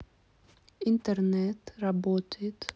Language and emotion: Russian, neutral